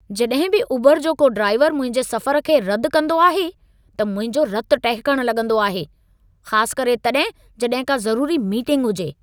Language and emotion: Sindhi, angry